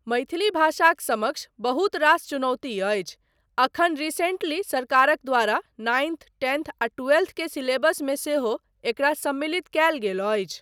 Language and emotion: Maithili, neutral